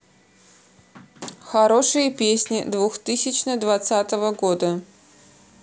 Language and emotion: Russian, neutral